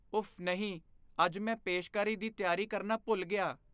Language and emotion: Punjabi, fearful